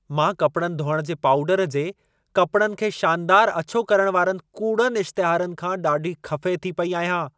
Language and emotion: Sindhi, angry